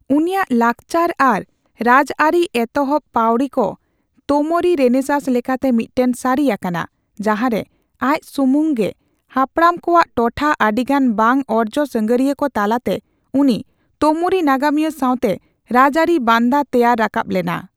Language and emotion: Santali, neutral